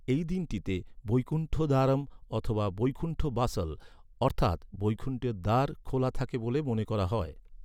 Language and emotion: Bengali, neutral